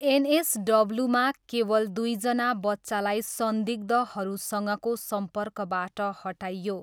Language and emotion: Nepali, neutral